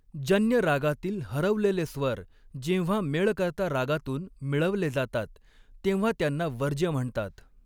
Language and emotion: Marathi, neutral